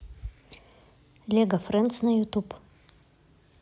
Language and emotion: Russian, neutral